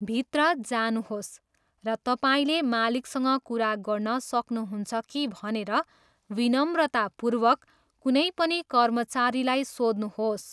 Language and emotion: Nepali, neutral